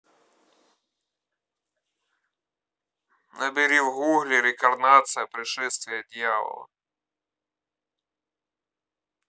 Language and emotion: Russian, neutral